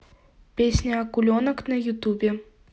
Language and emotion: Russian, neutral